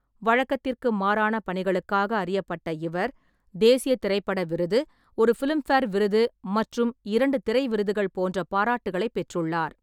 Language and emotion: Tamil, neutral